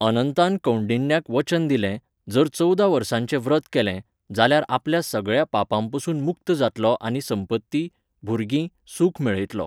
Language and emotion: Goan Konkani, neutral